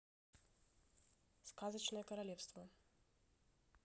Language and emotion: Russian, neutral